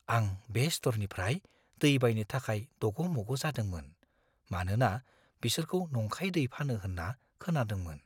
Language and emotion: Bodo, fearful